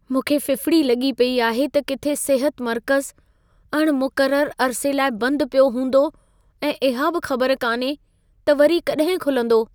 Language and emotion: Sindhi, fearful